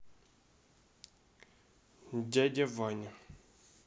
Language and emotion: Russian, neutral